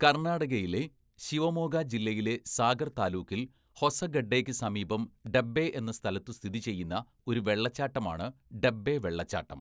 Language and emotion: Malayalam, neutral